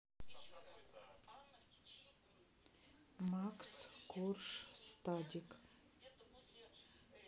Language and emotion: Russian, neutral